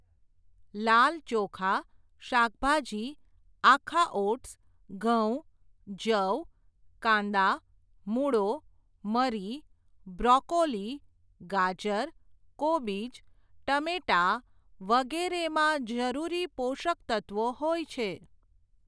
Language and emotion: Gujarati, neutral